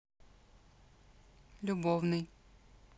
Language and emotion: Russian, neutral